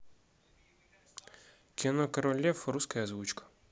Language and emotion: Russian, neutral